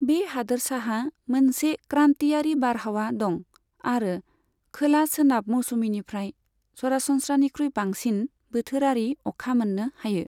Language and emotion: Bodo, neutral